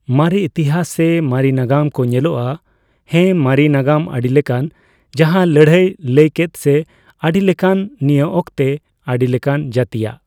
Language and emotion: Santali, neutral